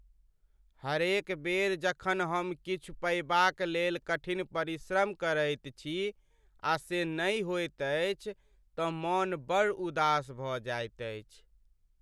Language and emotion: Maithili, sad